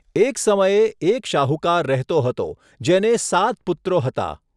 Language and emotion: Gujarati, neutral